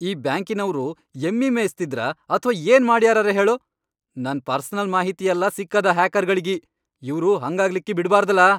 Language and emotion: Kannada, angry